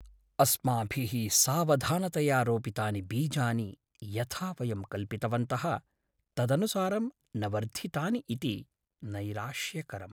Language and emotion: Sanskrit, sad